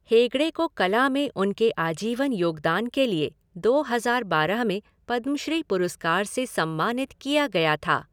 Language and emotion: Hindi, neutral